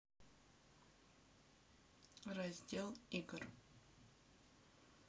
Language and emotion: Russian, neutral